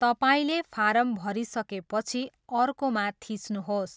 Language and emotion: Nepali, neutral